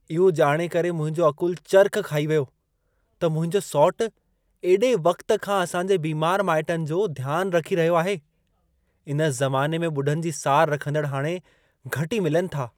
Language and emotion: Sindhi, surprised